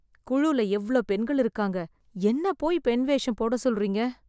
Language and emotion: Tamil, disgusted